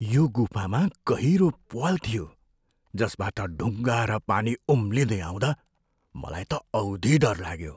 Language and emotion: Nepali, fearful